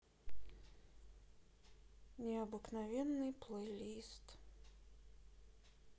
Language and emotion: Russian, sad